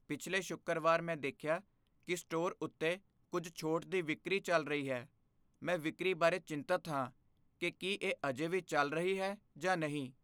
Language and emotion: Punjabi, fearful